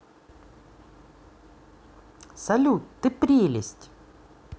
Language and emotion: Russian, positive